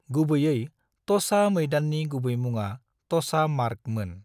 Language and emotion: Bodo, neutral